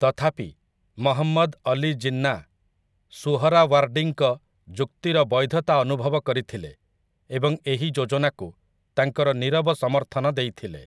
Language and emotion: Odia, neutral